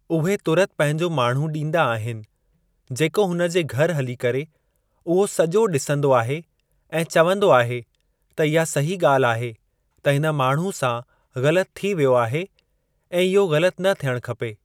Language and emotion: Sindhi, neutral